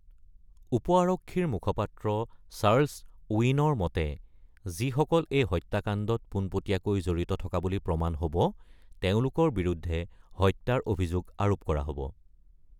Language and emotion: Assamese, neutral